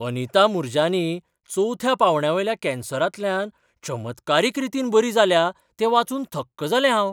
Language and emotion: Goan Konkani, surprised